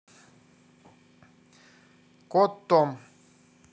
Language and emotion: Russian, neutral